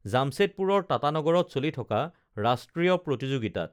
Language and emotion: Assamese, neutral